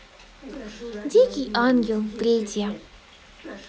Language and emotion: Russian, positive